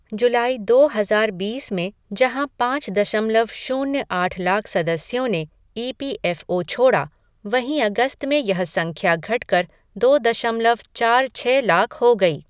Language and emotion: Hindi, neutral